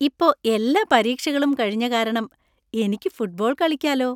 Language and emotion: Malayalam, happy